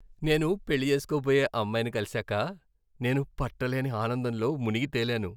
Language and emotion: Telugu, happy